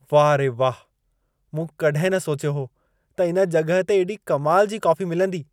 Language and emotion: Sindhi, surprised